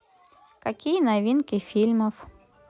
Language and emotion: Russian, neutral